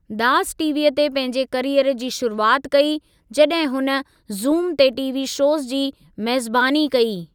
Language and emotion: Sindhi, neutral